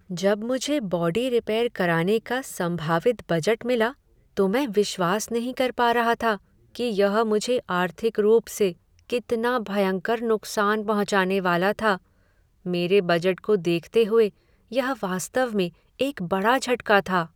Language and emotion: Hindi, sad